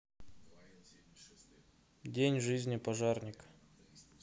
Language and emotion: Russian, neutral